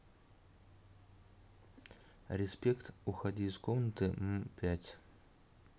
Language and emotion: Russian, neutral